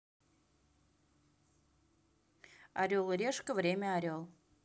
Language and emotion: Russian, neutral